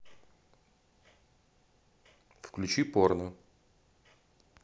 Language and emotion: Russian, neutral